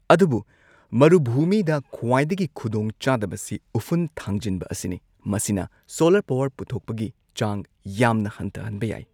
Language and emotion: Manipuri, neutral